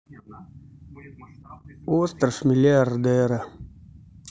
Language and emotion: Russian, sad